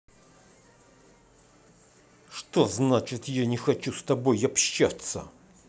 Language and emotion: Russian, angry